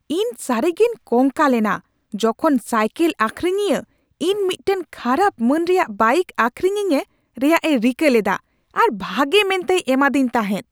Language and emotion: Santali, angry